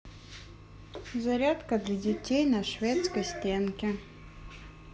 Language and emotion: Russian, neutral